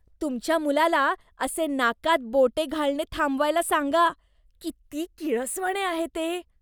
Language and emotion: Marathi, disgusted